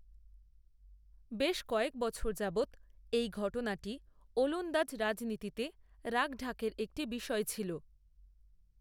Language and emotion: Bengali, neutral